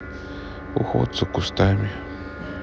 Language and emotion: Russian, neutral